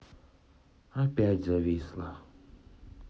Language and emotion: Russian, sad